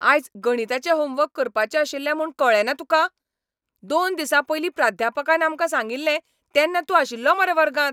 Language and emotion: Goan Konkani, angry